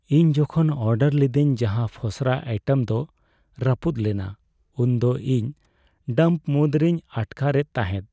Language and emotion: Santali, sad